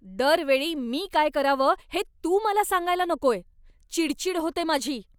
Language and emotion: Marathi, angry